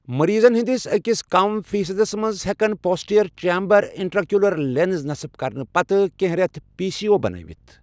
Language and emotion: Kashmiri, neutral